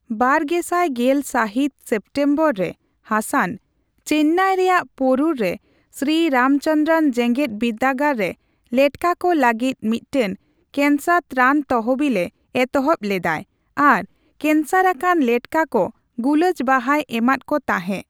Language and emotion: Santali, neutral